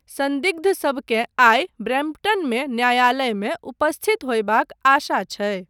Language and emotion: Maithili, neutral